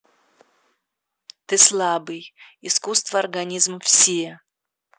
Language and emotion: Russian, neutral